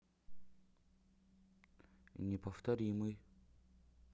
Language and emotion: Russian, neutral